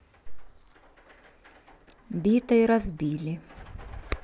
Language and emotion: Russian, neutral